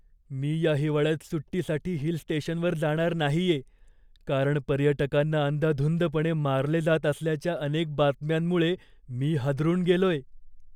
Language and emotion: Marathi, fearful